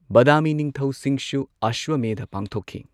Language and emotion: Manipuri, neutral